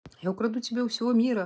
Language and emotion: Russian, neutral